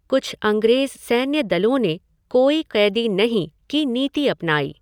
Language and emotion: Hindi, neutral